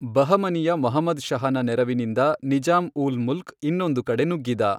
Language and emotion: Kannada, neutral